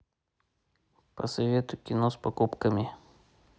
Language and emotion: Russian, neutral